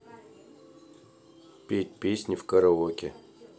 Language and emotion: Russian, neutral